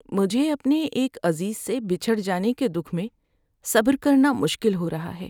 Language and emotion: Urdu, sad